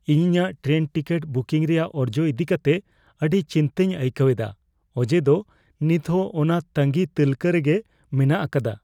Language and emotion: Santali, fearful